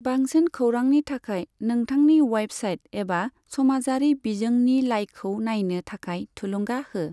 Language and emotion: Bodo, neutral